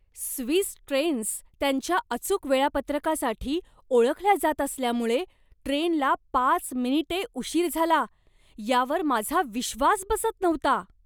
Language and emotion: Marathi, surprised